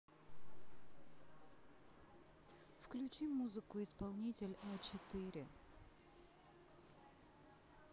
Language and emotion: Russian, neutral